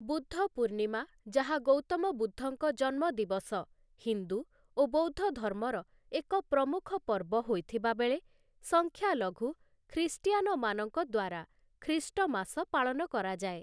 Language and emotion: Odia, neutral